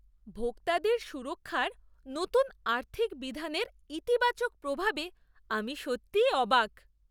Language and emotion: Bengali, surprised